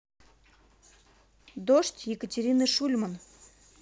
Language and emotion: Russian, neutral